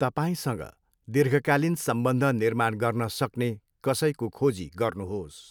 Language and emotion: Nepali, neutral